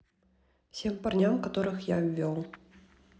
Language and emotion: Russian, neutral